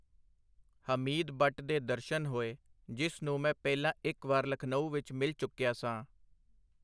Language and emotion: Punjabi, neutral